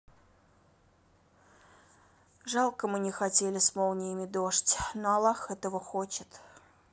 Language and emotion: Russian, sad